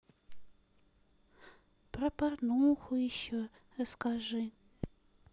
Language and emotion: Russian, sad